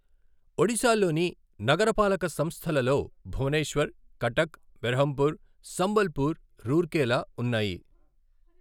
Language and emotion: Telugu, neutral